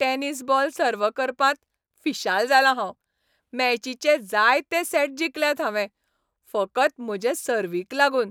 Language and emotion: Goan Konkani, happy